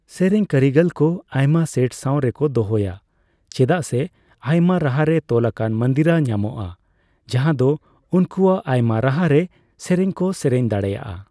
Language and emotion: Santali, neutral